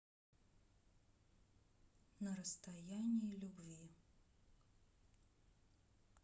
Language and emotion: Russian, neutral